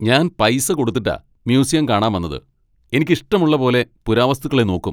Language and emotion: Malayalam, angry